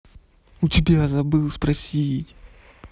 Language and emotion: Russian, angry